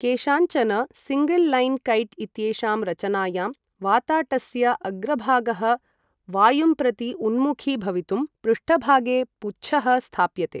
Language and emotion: Sanskrit, neutral